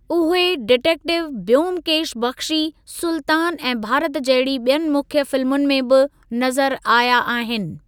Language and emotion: Sindhi, neutral